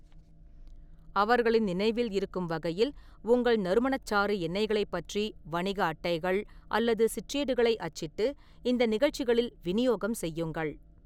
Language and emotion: Tamil, neutral